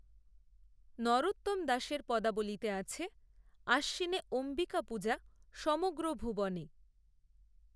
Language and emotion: Bengali, neutral